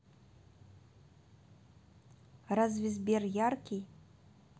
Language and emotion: Russian, neutral